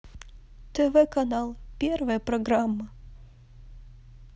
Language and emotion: Russian, sad